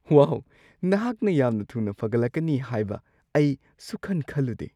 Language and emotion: Manipuri, surprised